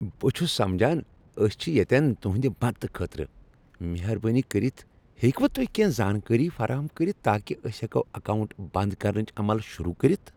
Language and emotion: Kashmiri, happy